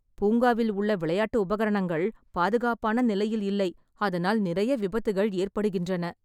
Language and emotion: Tamil, sad